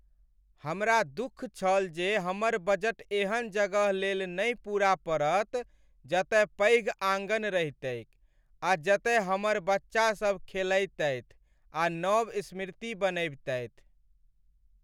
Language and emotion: Maithili, sad